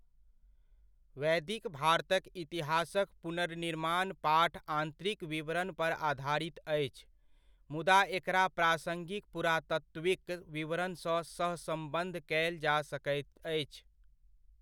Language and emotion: Maithili, neutral